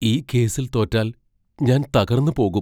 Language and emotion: Malayalam, fearful